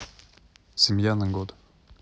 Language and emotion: Russian, neutral